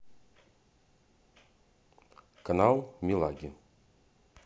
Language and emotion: Russian, neutral